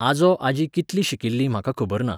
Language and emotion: Goan Konkani, neutral